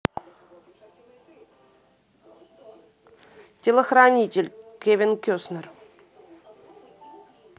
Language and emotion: Russian, neutral